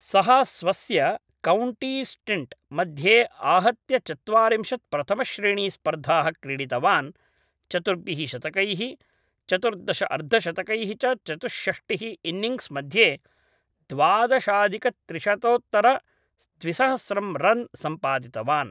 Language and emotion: Sanskrit, neutral